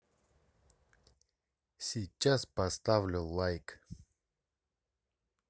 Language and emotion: Russian, neutral